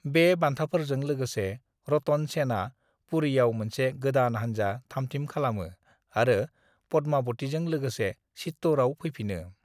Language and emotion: Bodo, neutral